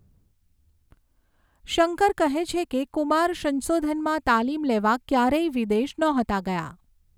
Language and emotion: Gujarati, neutral